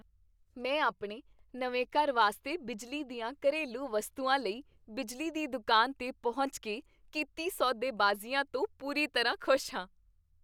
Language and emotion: Punjabi, happy